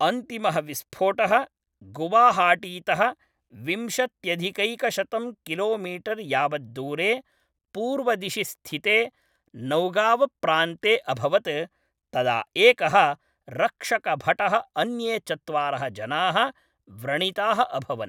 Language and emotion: Sanskrit, neutral